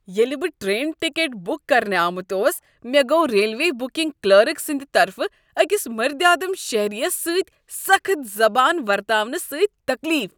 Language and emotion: Kashmiri, disgusted